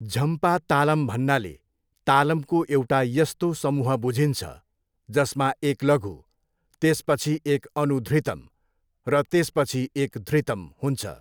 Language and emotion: Nepali, neutral